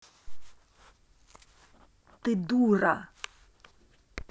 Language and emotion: Russian, angry